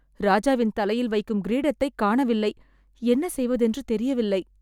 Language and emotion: Tamil, sad